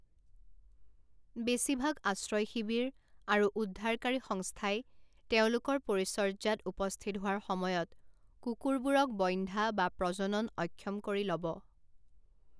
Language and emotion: Assamese, neutral